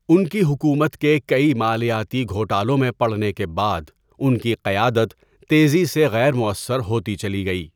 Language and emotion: Urdu, neutral